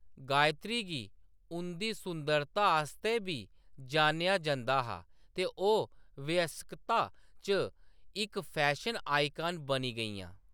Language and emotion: Dogri, neutral